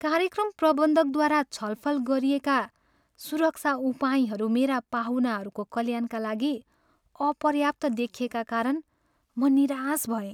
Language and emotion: Nepali, sad